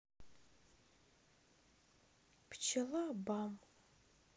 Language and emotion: Russian, sad